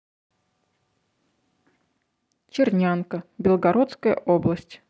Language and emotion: Russian, neutral